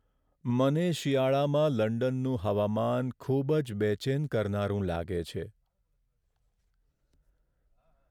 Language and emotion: Gujarati, sad